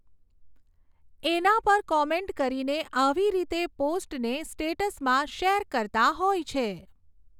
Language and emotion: Gujarati, neutral